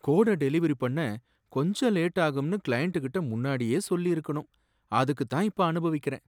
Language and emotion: Tamil, sad